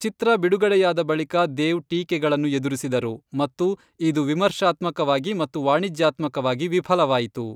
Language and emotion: Kannada, neutral